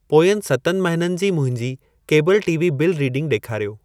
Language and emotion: Sindhi, neutral